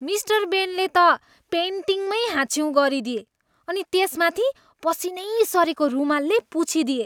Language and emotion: Nepali, disgusted